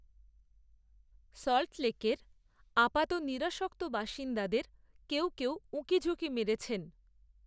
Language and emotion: Bengali, neutral